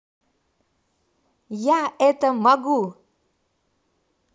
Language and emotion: Russian, positive